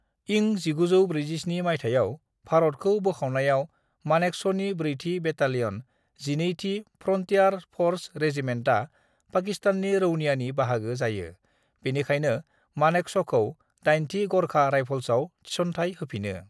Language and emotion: Bodo, neutral